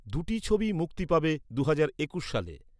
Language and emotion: Bengali, neutral